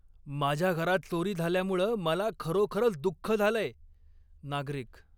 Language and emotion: Marathi, angry